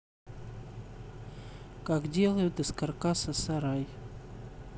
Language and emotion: Russian, neutral